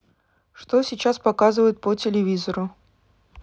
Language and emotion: Russian, neutral